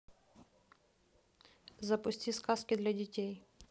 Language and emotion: Russian, neutral